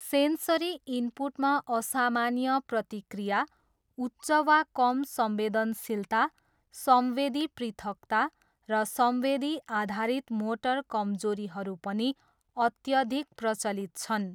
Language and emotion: Nepali, neutral